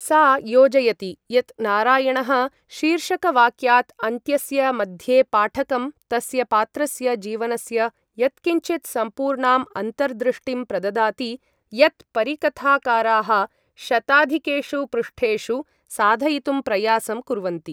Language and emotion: Sanskrit, neutral